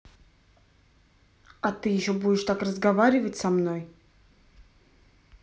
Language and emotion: Russian, angry